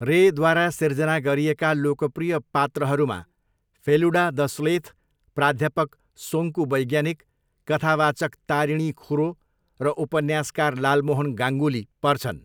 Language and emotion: Nepali, neutral